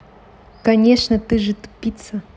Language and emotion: Russian, angry